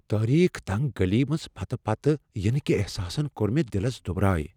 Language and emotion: Kashmiri, fearful